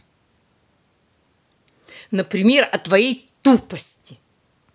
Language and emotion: Russian, angry